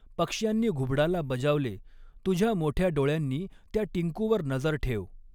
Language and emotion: Marathi, neutral